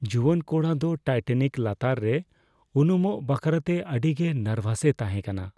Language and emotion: Santali, fearful